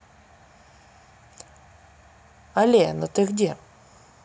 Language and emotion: Russian, neutral